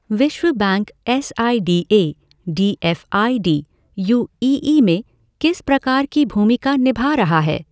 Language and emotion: Hindi, neutral